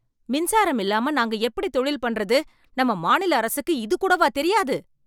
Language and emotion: Tamil, angry